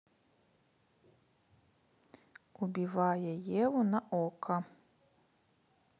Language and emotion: Russian, neutral